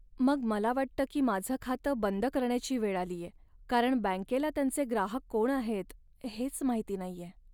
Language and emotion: Marathi, sad